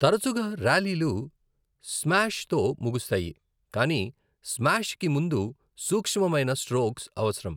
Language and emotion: Telugu, neutral